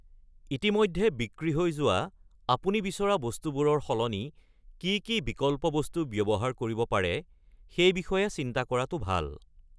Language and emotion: Assamese, neutral